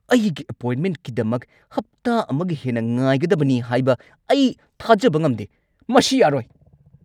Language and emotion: Manipuri, angry